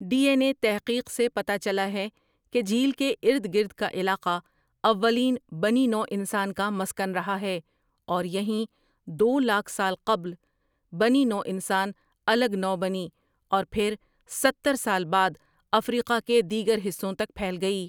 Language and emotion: Urdu, neutral